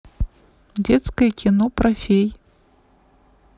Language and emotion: Russian, neutral